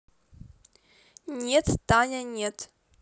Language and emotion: Russian, neutral